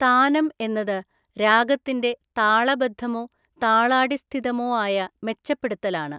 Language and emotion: Malayalam, neutral